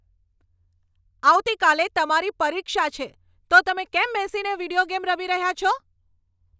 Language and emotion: Gujarati, angry